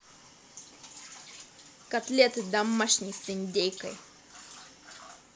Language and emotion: Russian, positive